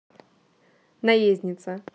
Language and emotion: Russian, neutral